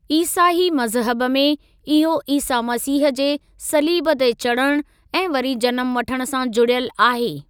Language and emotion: Sindhi, neutral